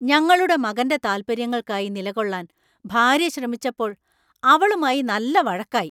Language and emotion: Malayalam, angry